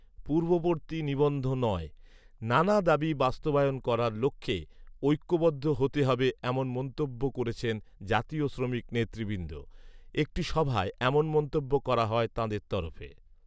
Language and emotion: Bengali, neutral